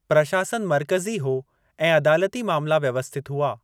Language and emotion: Sindhi, neutral